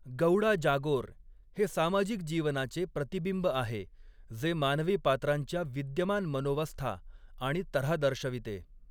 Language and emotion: Marathi, neutral